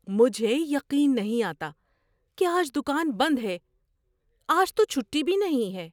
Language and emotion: Urdu, surprised